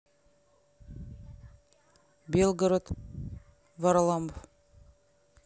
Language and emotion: Russian, neutral